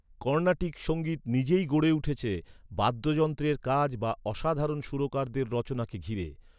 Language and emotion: Bengali, neutral